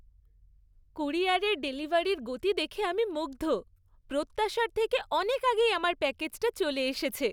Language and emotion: Bengali, happy